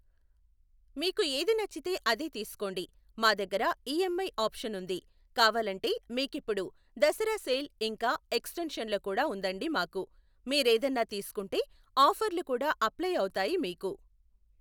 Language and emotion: Telugu, neutral